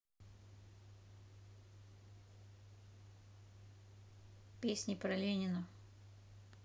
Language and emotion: Russian, neutral